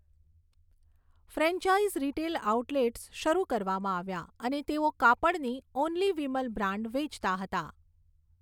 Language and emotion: Gujarati, neutral